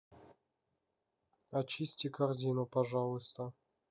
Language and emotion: Russian, neutral